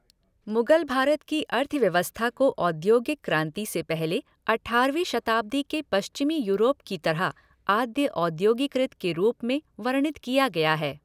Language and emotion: Hindi, neutral